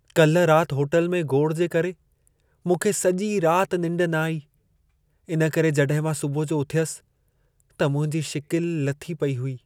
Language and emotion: Sindhi, sad